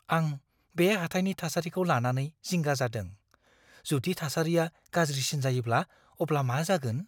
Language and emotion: Bodo, fearful